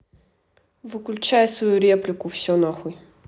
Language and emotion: Russian, angry